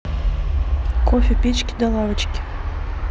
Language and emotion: Russian, neutral